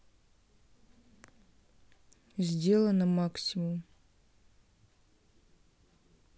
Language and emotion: Russian, neutral